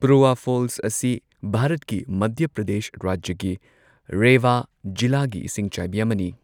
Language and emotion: Manipuri, neutral